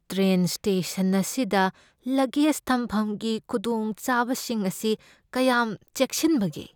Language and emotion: Manipuri, fearful